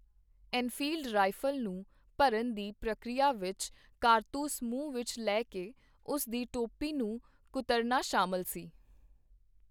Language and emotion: Punjabi, neutral